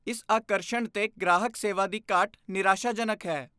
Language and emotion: Punjabi, disgusted